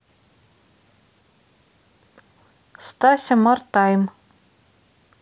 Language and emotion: Russian, neutral